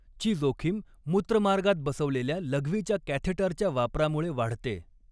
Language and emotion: Marathi, neutral